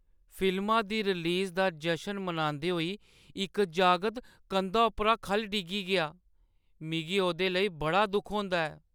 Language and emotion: Dogri, sad